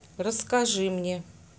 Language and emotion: Russian, neutral